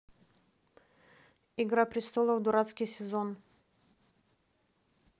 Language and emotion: Russian, neutral